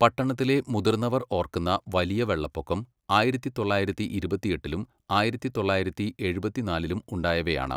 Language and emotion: Malayalam, neutral